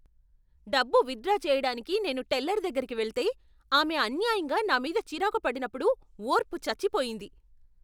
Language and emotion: Telugu, angry